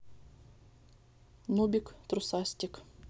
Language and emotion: Russian, neutral